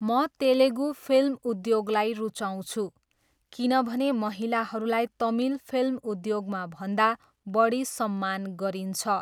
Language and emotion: Nepali, neutral